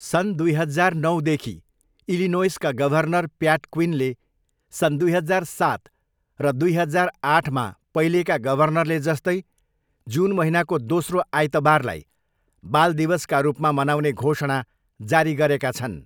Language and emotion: Nepali, neutral